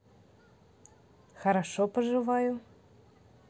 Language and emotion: Russian, positive